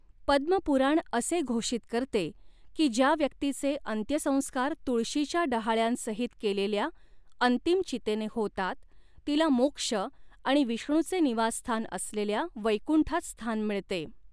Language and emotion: Marathi, neutral